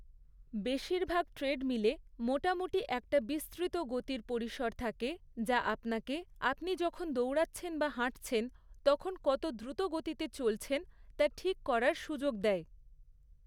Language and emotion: Bengali, neutral